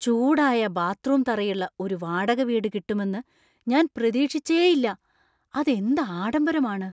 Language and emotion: Malayalam, surprised